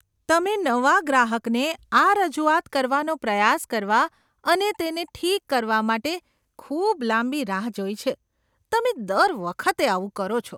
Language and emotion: Gujarati, disgusted